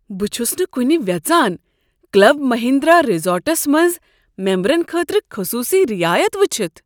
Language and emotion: Kashmiri, surprised